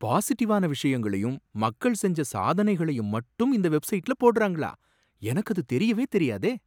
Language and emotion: Tamil, surprised